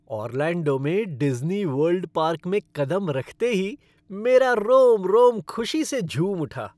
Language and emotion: Hindi, happy